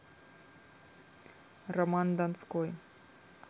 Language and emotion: Russian, neutral